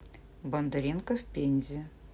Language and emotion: Russian, neutral